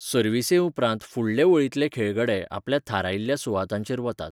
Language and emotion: Goan Konkani, neutral